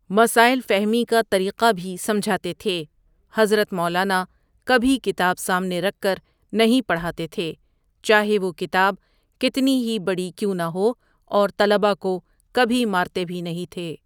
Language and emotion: Urdu, neutral